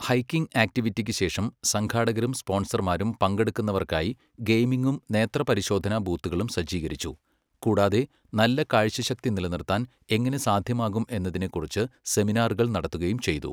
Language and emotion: Malayalam, neutral